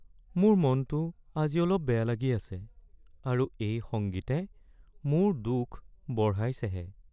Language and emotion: Assamese, sad